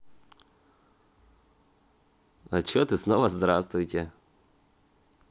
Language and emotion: Russian, positive